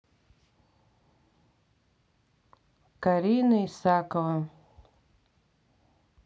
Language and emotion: Russian, neutral